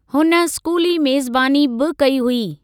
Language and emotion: Sindhi, neutral